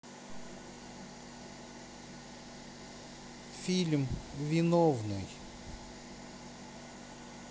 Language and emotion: Russian, neutral